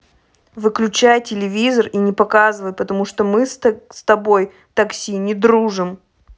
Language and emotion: Russian, angry